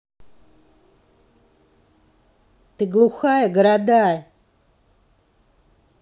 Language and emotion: Russian, angry